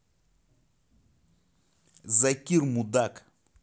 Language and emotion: Russian, angry